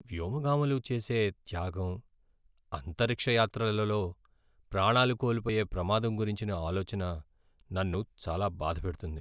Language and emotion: Telugu, sad